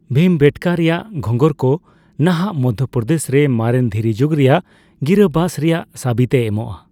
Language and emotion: Santali, neutral